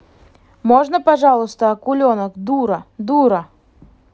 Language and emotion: Russian, angry